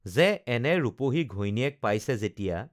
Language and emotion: Assamese, neutral